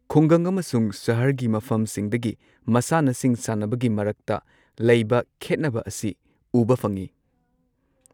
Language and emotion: Manipuri, neutral